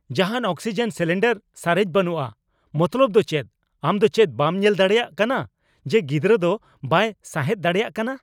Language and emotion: Santali, angry